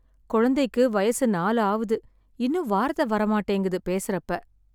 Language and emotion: Tamil, sad